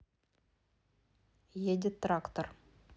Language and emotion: Russian, neutral